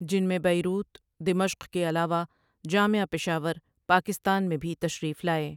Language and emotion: Urdu, neutral